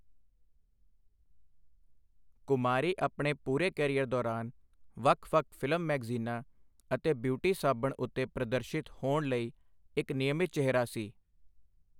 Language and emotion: Punjabi, neutral